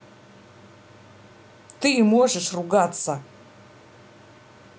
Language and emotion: Russian, angry